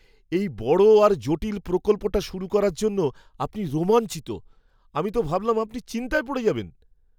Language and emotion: Bengali, surprised